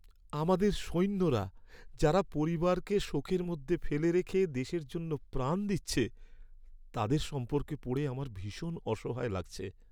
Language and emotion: Bengali, sad